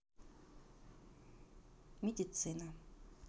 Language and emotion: Russian, neutral